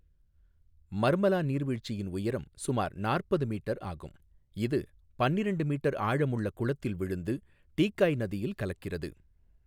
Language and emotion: Tamil, neutral